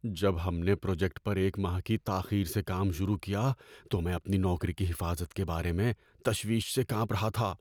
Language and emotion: Urdu, fearful